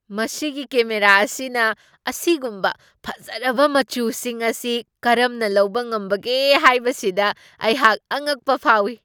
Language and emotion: Manipuri, surprised